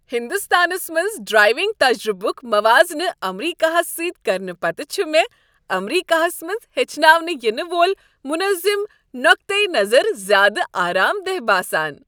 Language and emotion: Kashmiri, happy